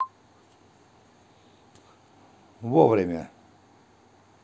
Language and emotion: Russian, neutral